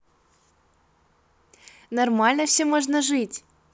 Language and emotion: Russian, positive